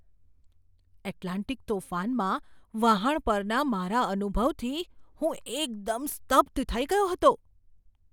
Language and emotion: Gujarati, surprised